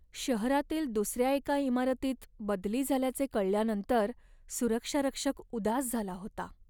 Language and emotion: Marathi, sad